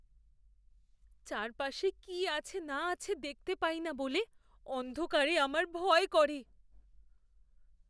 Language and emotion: Bengali, fearful